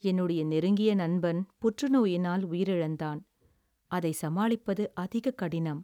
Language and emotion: Tamil, sad